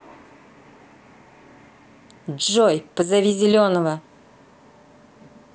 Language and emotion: Russian, angry